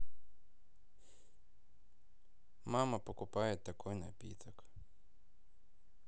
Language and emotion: Russian, neutral